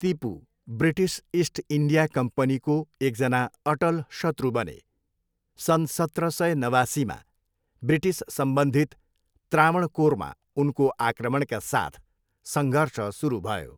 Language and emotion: Nepali, neutral